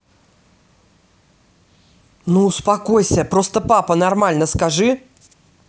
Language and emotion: Russian, angry